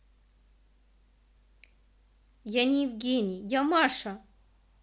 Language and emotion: Russian, angry